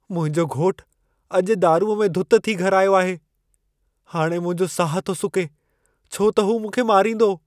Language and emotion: Sindhi, fearful